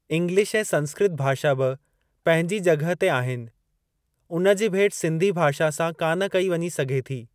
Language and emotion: Sindhi, neutral